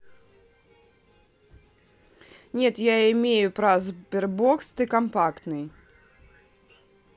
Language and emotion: Russian, neutral